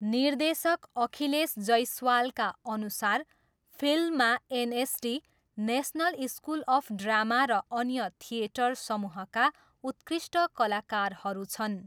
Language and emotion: Nepali, neutral